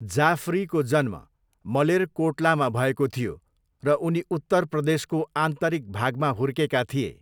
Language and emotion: Nepali, neutral